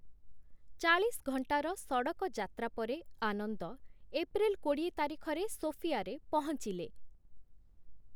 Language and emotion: Odia, neutral